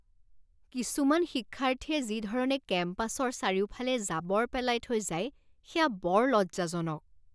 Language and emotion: Assamese, disgusted